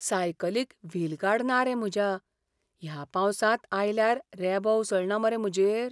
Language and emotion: Goan Konkani, fearful